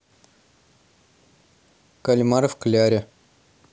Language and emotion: Russian, neutral